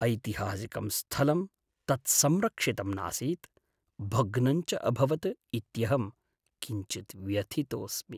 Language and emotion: Sanskrit, sad